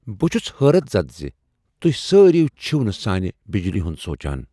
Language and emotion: Kashmiri, surprised